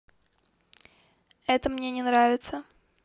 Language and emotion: Russian, neutral